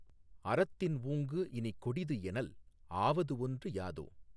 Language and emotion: Tamil, neutral